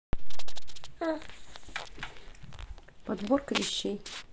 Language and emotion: Russian, neutral